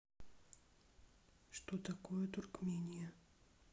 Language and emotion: Russian, neutral